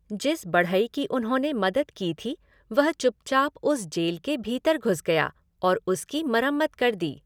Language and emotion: Hindi, neutral